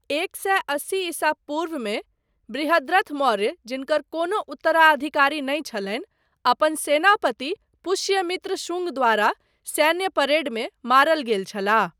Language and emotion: Maithili, neutral